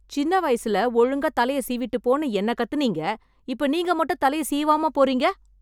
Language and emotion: Tamil, angry